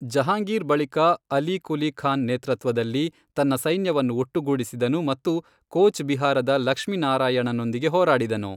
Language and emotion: Kannada, neutral